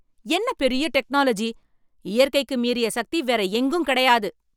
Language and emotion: Tamil, angry